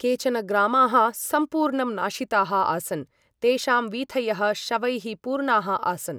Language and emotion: Sanskrit, neutral